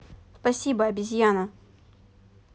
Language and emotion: Russian, neutral